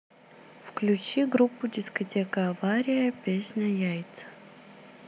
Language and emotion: Russian, neutral